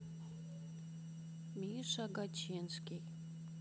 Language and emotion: Russian, neutral